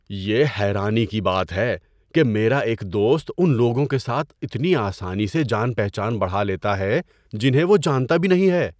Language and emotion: Urdu, surprised